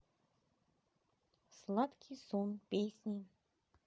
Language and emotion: Russian, neutral